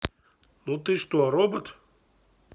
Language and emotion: Russian, neutral